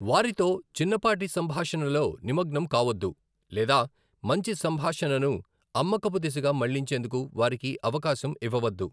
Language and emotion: Telugu, neutral